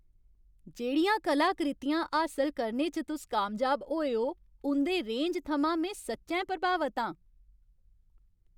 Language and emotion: Dogri, happy